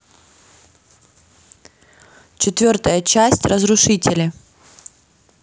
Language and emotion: Russian, neutral